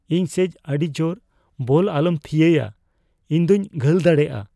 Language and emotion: Santali, fearful